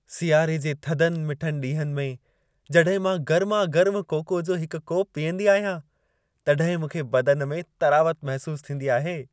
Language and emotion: Sindhi, happy